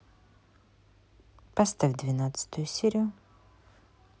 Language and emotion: Russian, neutral